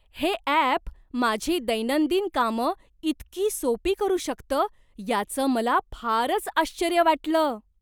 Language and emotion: Marathi, surprised